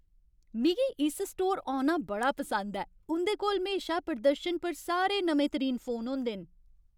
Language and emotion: Dogri, happy